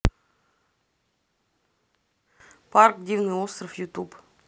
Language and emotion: Russian, neutral